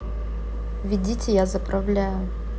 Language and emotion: Russian, neutral